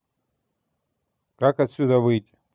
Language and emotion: Russian, neutral